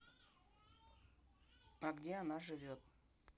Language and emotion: Russian, neutral